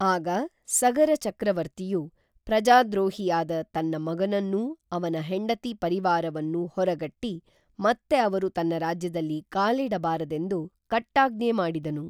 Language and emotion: Kannada, neutral